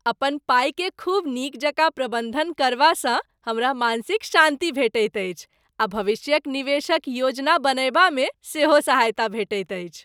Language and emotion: Maithili, happy